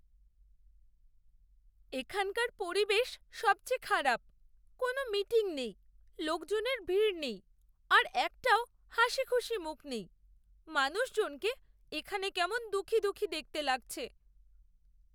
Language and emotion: Bengali, sad